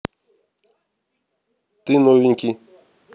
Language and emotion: Russian, neutral